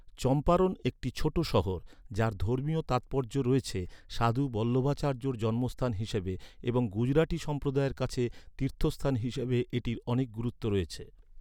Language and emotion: Bengali, neutral